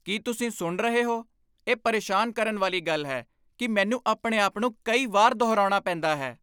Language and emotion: Punjabi, angry